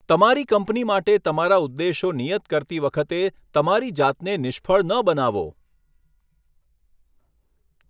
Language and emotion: Gujarati, neutral